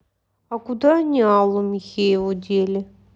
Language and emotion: Russian, sad